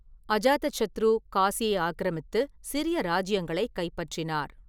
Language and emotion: Tamil, neutral